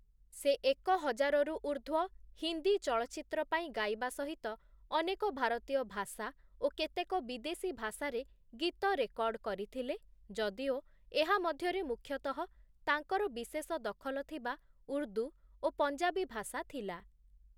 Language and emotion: Odia, neutral